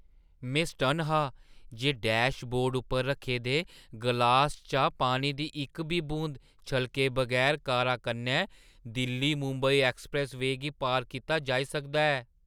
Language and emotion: Dogri, surprised